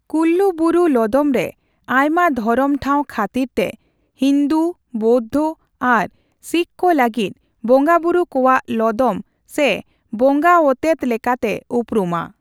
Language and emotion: Santali, neutral